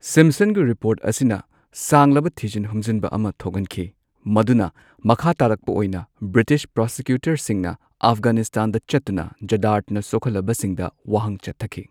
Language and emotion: Manipuri, neutral